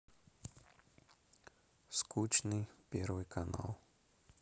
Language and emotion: Russian, sad